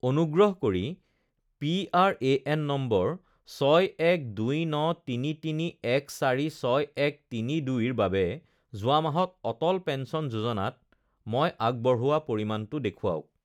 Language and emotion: Assamese, neutral